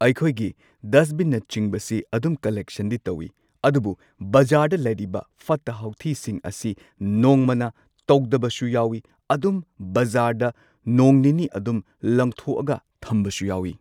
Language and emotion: Manipuri, neutral